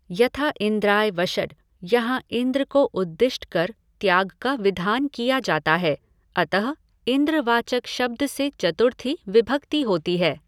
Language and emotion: Hindi, neutral